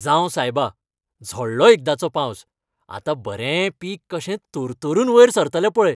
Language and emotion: Goan Konkani, happy